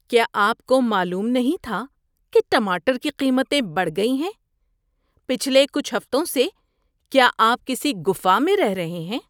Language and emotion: Urdu, disgusted